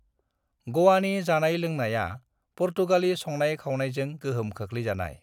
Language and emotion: Bodo, neutral